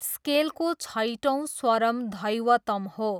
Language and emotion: Nepali, neutral